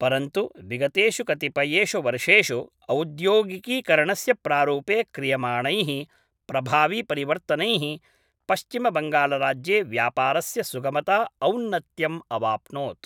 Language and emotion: Sanskrit, neutral